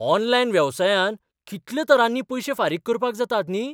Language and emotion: Goan Konkani, surprised